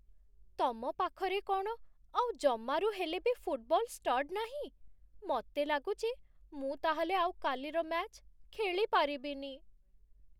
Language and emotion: Odia, sad